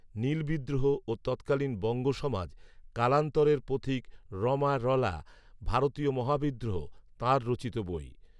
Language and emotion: Bengali, neutral